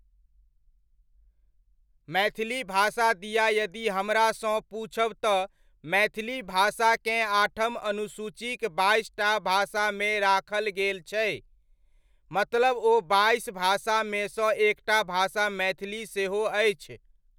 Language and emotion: Maithili, neutral